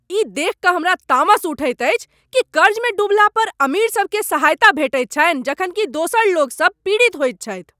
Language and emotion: Maithili, angry